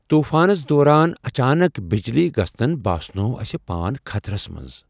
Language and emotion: Kashmiri, fearful